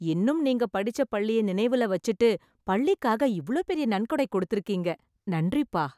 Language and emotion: Tamil, happy